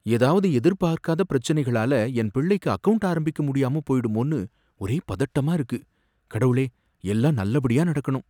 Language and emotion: Tamil, fearful